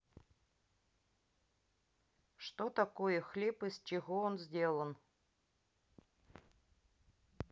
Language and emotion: Russian, neutral